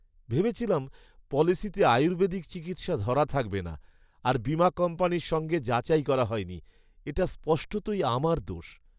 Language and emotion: Bengali, sad